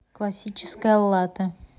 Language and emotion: Russian, neutral